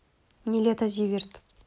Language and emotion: Russian, neutral